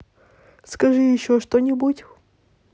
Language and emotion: Russian, neutral